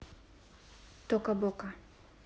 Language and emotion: Russian, neutral